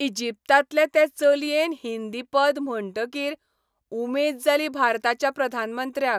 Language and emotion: Goan Konkani, happy